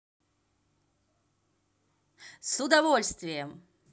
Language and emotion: Russian, positive